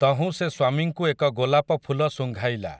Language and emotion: Odia, neutral